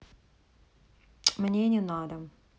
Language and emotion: Russian, neutral